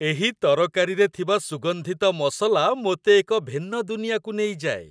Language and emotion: Odia, happy